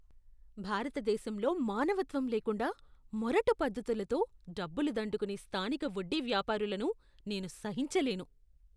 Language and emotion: Telugu, disgusted